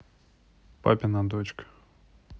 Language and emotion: Russian, neutral